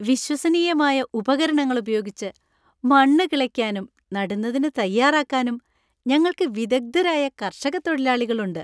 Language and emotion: Malayalam, happy